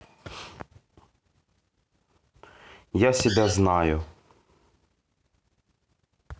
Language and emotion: Russian, neutral